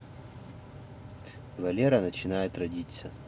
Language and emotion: Russian, neutral